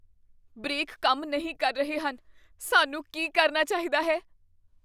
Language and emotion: Punjabi, fearful